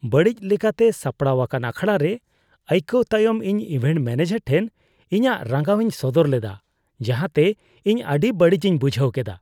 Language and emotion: Santali, disgusted